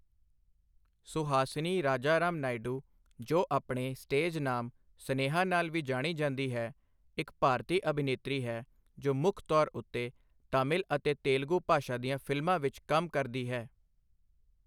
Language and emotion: Punjabi, neutral